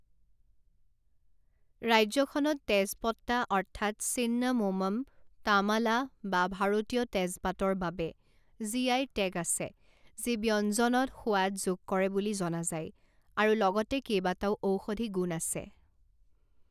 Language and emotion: Assamese, neutral